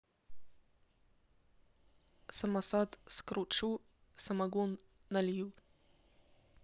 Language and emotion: Russian, neutral